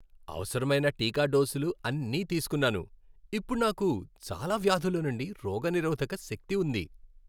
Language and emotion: Telugu, happy